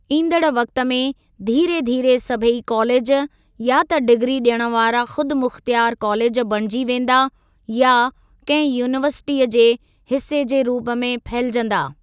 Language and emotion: Sindhi, neutral